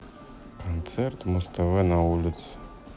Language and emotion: Russian, sad